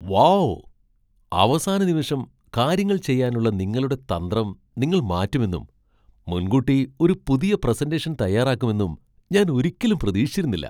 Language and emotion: Malayalam, surprised